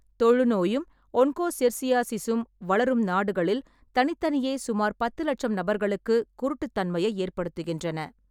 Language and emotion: Tamil, neutral